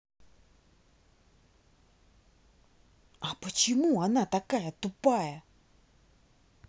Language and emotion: Russian, angry